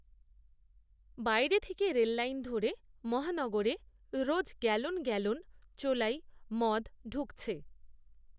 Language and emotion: Bengali, neutral